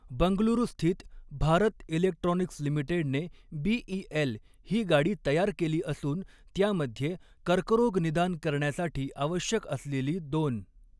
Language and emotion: Marathi, neutral